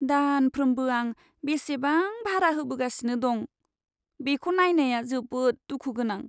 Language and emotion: Bodo, sad